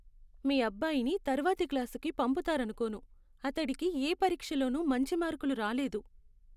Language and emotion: Telugu, sad